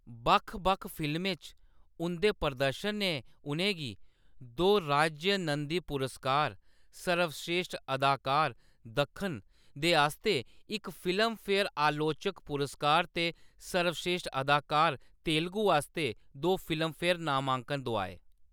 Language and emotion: Dogri, neutral